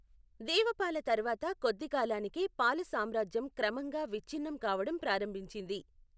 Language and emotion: Telugu, neutral